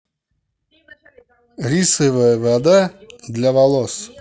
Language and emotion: Russian, positive